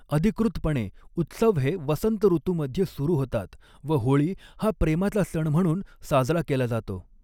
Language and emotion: Marathi, neutral